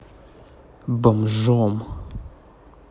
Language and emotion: Russian, angry